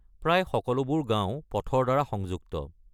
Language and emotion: Assamese, neutral